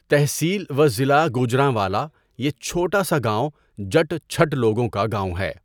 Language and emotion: Urdu, neutral